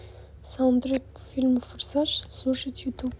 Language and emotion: Russian, neutral